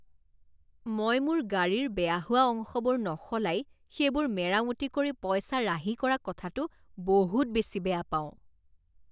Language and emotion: Assamese, disgusted